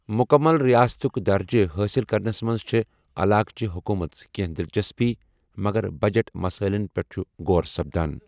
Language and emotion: Kashmiri, neutral